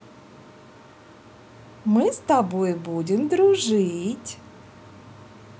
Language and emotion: Russian, positive